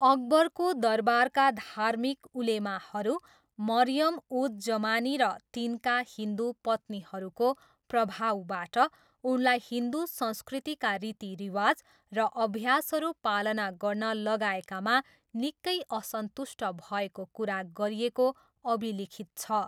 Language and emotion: Nepali, neutral